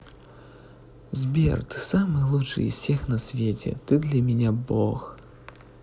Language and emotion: Russian, positive